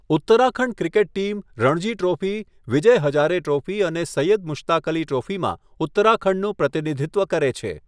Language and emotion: Gujarati, neutral